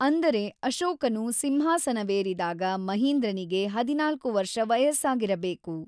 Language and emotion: Kannada, neutral